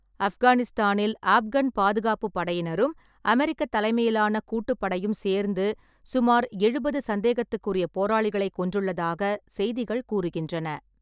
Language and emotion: Tamil, neutral